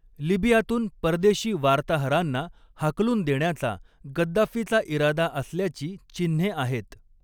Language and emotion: Marathi, neutral